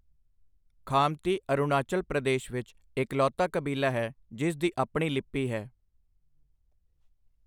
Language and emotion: Punjabi, neutral